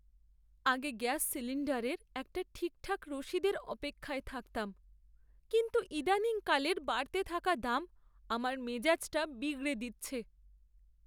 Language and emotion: Bengali, sad